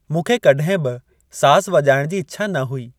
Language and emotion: Sindhi, neutral